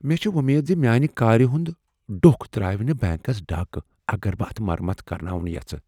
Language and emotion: Kashmiri, fearful